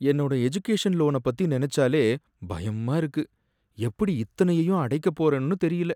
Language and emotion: Tamil, sad